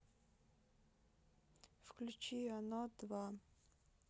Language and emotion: Russian, neutral